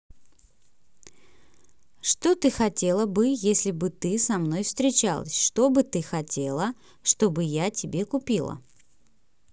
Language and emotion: Russian, positive